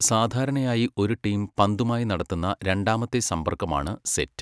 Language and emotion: Malayalam, neutral